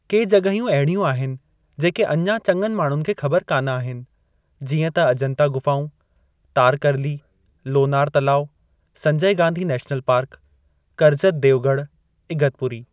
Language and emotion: Sindhi, neutral